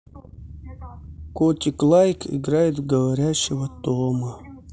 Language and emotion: Russian, sad